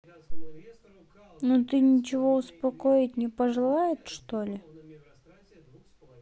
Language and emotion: Russian, sad